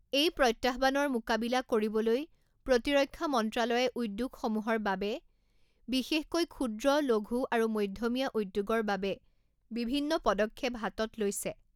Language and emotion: Assamese, neutral